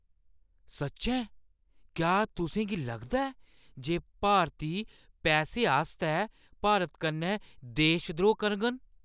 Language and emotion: Dogri, surprised